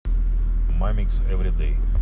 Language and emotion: Russian, neutral